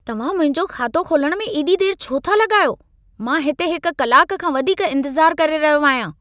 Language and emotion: Sindhi, angry